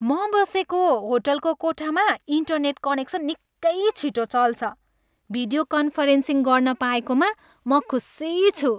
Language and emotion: Nepali, happy